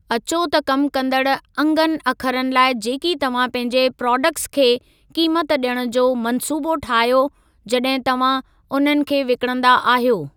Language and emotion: Sindhi, neutral